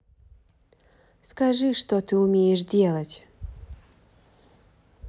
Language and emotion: Russian, neutral